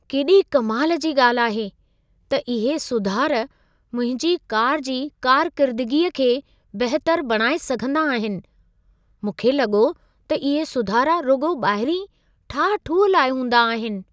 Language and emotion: Sindhi, surprised